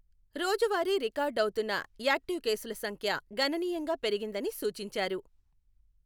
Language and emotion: Telugu, neutral